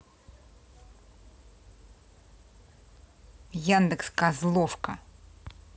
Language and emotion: Russian, angry